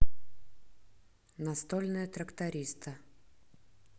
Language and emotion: Russian, neutral